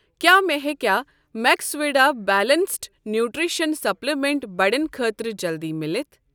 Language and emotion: Kashmiri, neutral